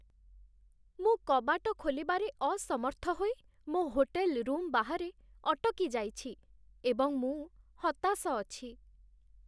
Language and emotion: Odia, sad